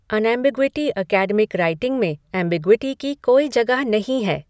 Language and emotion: Hindi, neutral